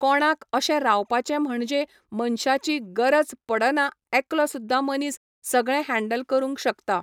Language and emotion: Goan Konkani, neutral